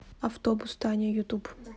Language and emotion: Russian, neutral